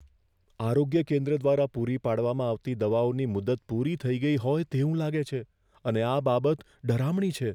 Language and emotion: Gujarati, fearful